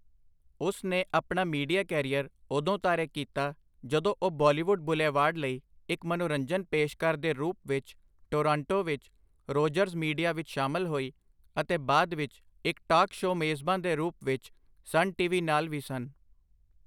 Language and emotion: Punjabi, neutral